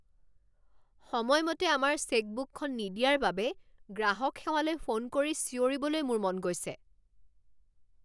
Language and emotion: Assamese, angry